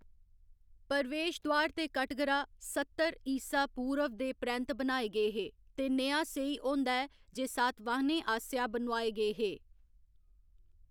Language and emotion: Dogri, neutral